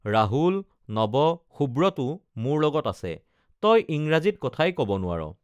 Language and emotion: Assamese, neutral